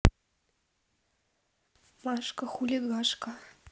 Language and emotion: Russian, neutral